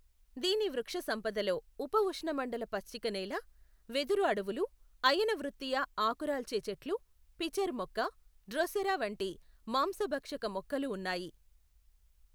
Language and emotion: Telugu, neutral